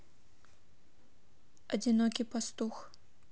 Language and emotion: Russian, neutral